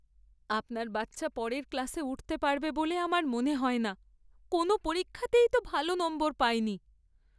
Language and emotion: Bengali, sad